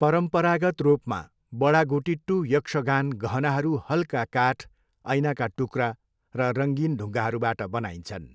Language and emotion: Nepali, neutral